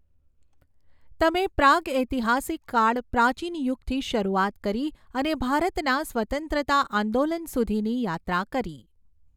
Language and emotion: Gujarati, neutral